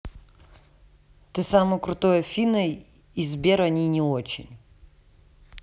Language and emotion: Russian, neutral